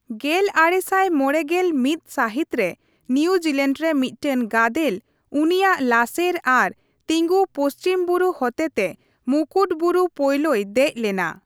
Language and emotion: Santali, neutral